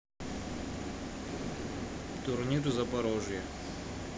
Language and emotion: Russian, neutral